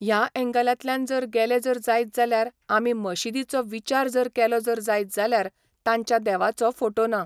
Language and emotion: Goan Konkani, neutral